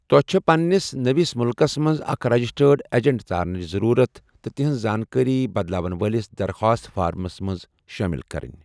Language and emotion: Kashmiri, neutral